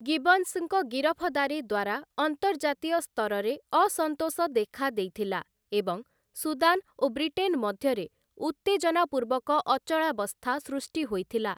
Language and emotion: Odia, neutral